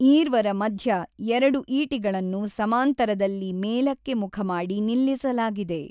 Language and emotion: Kannada, neutral